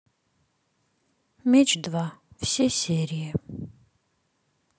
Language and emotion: Russian, sad